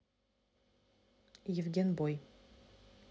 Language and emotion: Russian, neutral